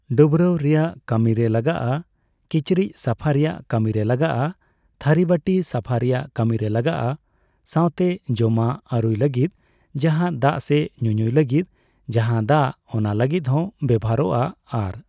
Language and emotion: Santali, neutral